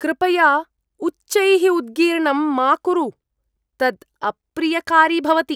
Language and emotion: Sanskrit, disgusted